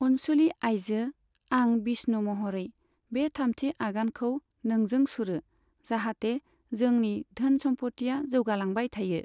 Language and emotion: Bodo, neutral